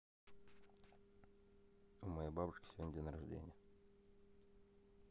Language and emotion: Russian, neutral